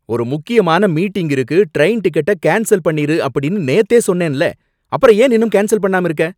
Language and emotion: Tamil, angry